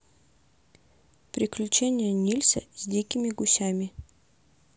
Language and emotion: Russian, neutral